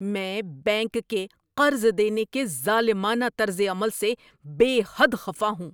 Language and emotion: Urdu, angry